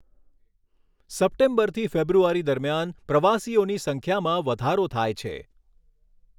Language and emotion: Gujarati, neutral